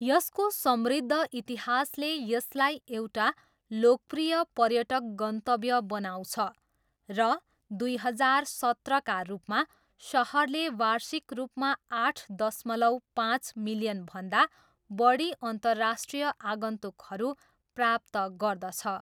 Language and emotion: Nepali, neutral